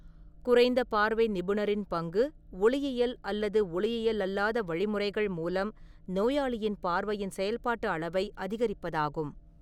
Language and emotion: Tamil, neutral